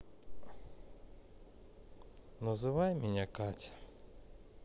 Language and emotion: Russian, sad